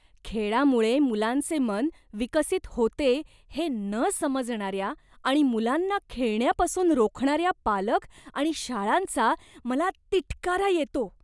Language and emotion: Marathi, disgusted